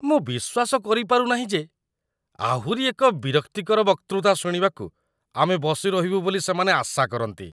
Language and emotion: Odia, disgusted